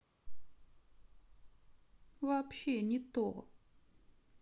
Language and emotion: Russian, sad